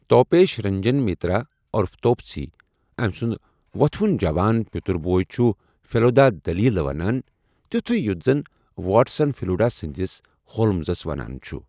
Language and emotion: Kashmiri, neutral